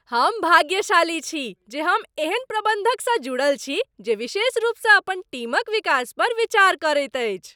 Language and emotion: Maithili, happy